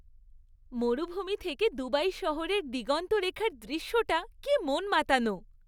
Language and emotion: Bengali, happy